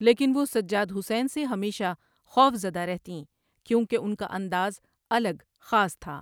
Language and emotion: Urdu, neutral